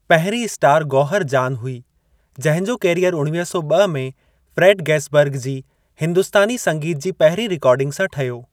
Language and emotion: Sindhi, neutral